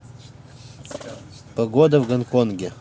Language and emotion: Russian, neutral